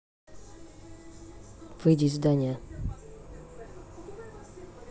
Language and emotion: Russian, neutral